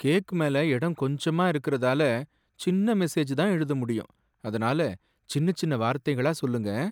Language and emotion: Tamil, sad